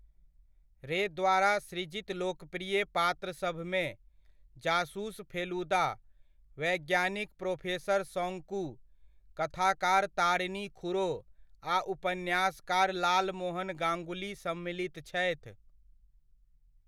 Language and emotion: Maithili, neutral